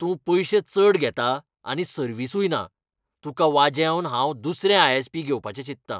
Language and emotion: Goan Konkani, angry